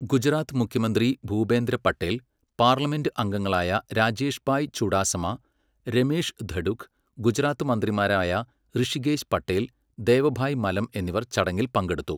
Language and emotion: Malayalam, neutral